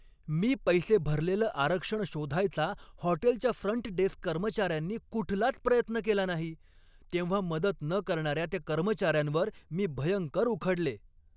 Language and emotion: Marathi, angry